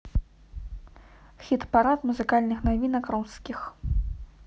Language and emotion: Russian, neutral